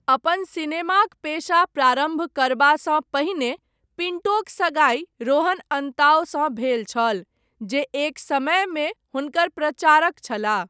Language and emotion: Maithili, neutral